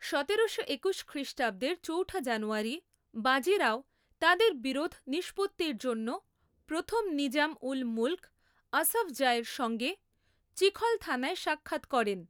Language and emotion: Bengali, neutral